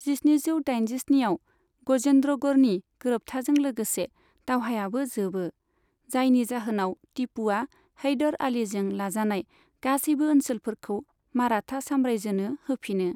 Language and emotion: Bodo, neutral